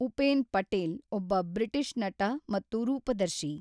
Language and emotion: Kannada, neutral